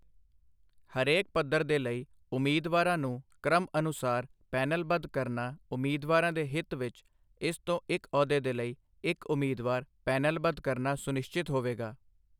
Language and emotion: Punjabi, neutral